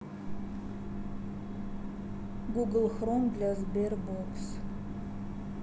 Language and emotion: Russian, neutral